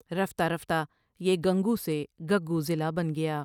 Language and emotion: Urdu, neutral